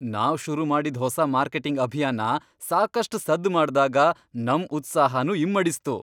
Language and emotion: Kannada, happy